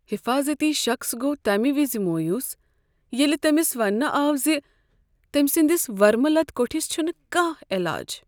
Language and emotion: Kashmiri, sad